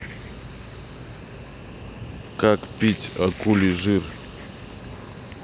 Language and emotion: Russian, neutral